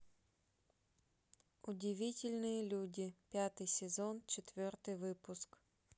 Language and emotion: Russian, neutral